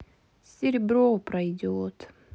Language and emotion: Russian, sad